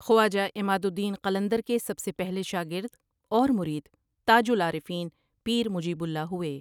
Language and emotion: Urdu, neutral